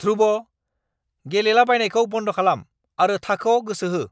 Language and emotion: Bodo, angry